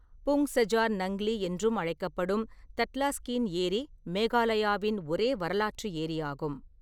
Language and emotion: Tamil, neutral